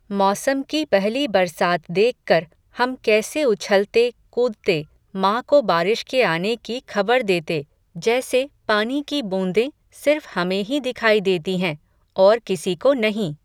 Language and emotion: Hindi, neutral